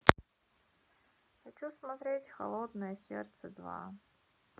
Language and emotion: Russian, sad